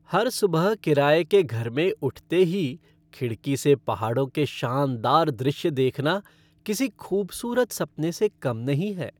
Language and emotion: Hindi, happy